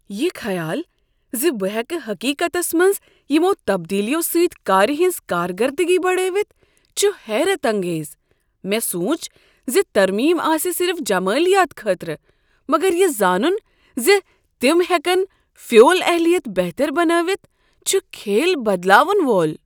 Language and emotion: Kashmiri, surprised